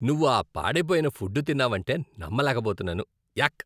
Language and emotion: Telugu, disgusted